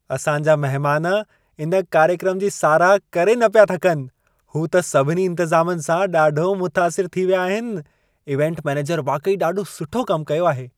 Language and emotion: Sindhi, happy